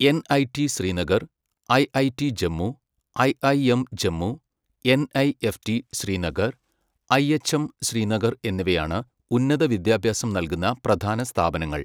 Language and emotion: Malayalam, neutral